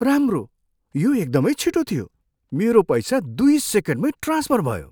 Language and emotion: Nepali, surprised